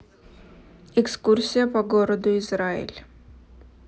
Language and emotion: Russian, neutral